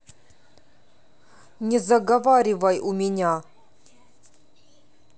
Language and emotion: Russian, angry